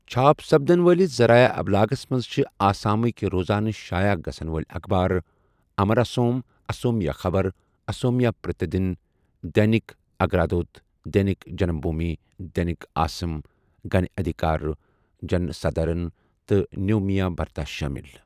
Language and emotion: Kashmiri, neutral